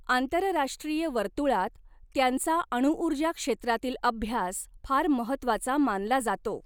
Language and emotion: Marathi, neutral